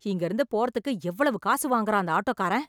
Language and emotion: Tamil, angry